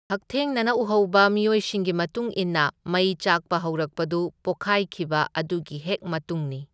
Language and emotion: Manipuri, neutral